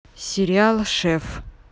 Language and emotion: Russian, neutral